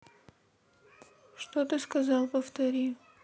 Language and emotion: Russian, neutral